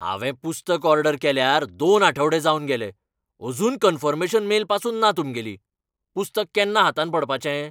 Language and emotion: Goan Konkani, angry